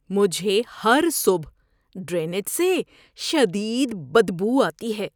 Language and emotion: Urdu, disgusted